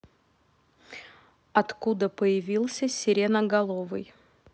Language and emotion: Russian, neutral